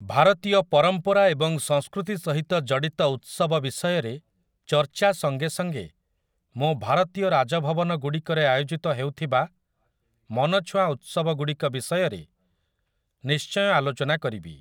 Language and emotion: Odia, neutral